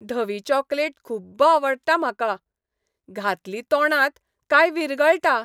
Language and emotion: Goan Konkani, happy